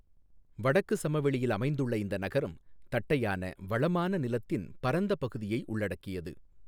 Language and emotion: Tamil, neutral